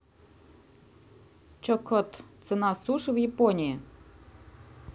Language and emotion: Russian, neutral